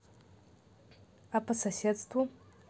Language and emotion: Russian, neutral